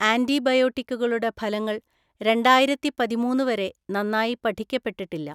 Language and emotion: Malayalam, neutral